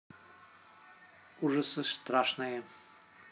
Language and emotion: Russian, neutral